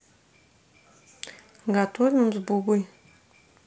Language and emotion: Russian, neutral